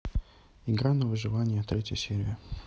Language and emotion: Russian, neutral